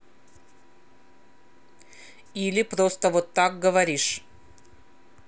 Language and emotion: Russian, angry